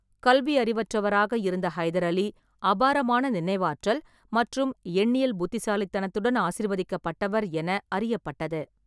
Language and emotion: Tamil, neutral